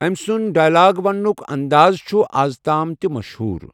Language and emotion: Kashmiri, neutral